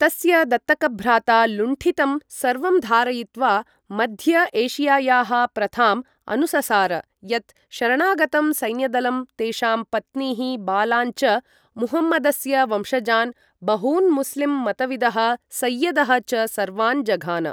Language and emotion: Sanskrit, neutral